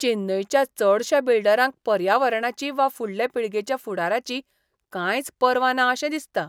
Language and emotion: Goan Konkani, disgusted